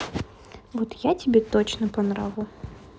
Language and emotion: Russian, neutral